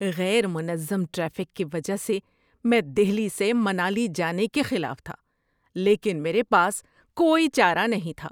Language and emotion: Urdu, disgusted